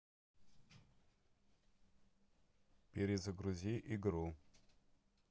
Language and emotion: Russian, neutral